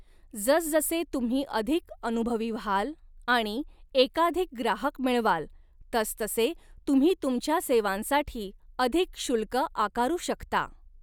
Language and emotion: Marathi, neutral